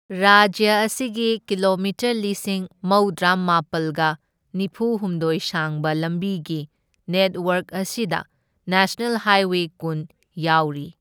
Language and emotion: Manipuri, neutral